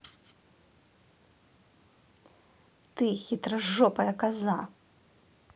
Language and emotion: Russian, angry